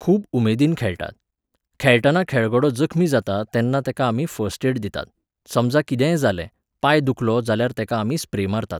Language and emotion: Goan Konkani, neutral